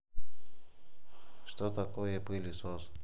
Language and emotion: Russian, neutral